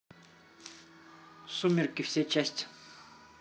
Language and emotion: Russian, neutral